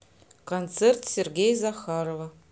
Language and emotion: Russian, neutral